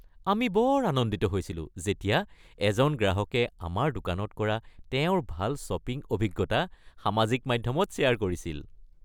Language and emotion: Assamese, happy